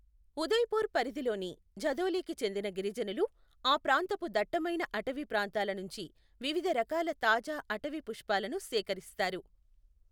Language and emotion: Telugu, neutral